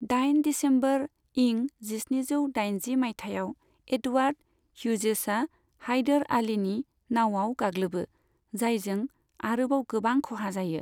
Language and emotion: Bodo, neutral